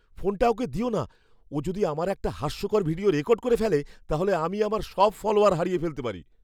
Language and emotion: Bengali, fearful